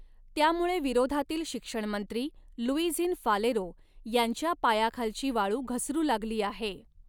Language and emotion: Marathi, neutral